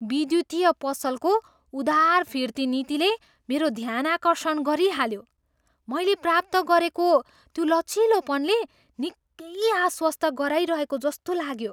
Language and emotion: Nepali, surprised